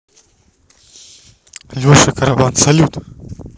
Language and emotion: Russian, neutral